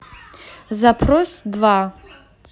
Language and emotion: Russian, neutral